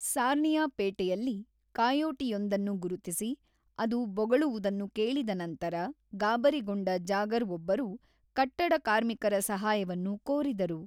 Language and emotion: Kannada, neutral